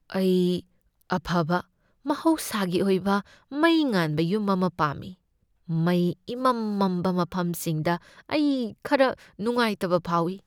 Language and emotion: Manipuri, fearful